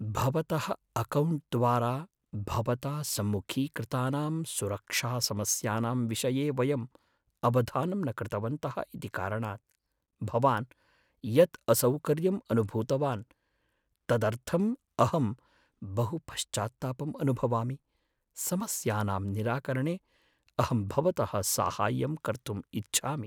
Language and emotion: Sanskrit, sad